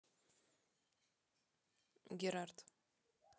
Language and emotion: Russian, neutral